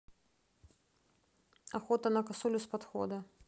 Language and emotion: Russian, neutral